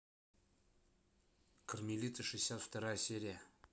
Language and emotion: Russian, neutral